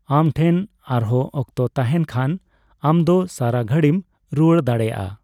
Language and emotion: Santali, neutral